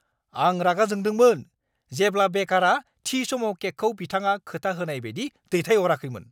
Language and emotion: Bodo, angry